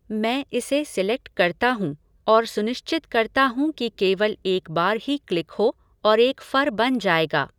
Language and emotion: Hindi, neutral